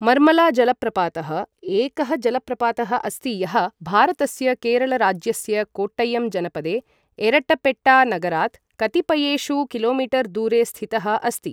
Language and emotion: Sanskrit, neutral